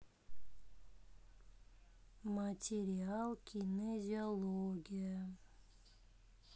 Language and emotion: Russian, neutral